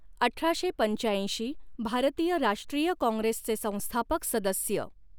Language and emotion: Marathi, neutral